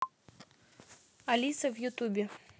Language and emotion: Russian, neutral